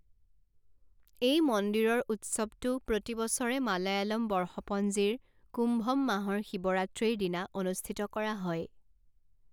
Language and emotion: Assamese, neutral